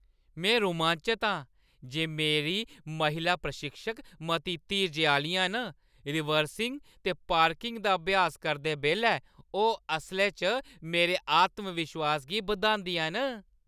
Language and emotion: Dogri, happy